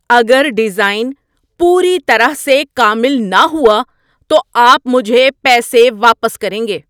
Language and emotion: Urdu, angry